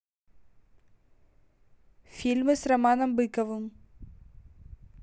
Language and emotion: Russian, neutral